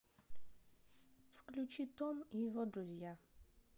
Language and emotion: Russian, neutral